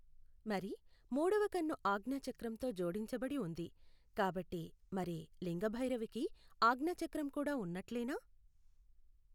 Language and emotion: Telugu, neutral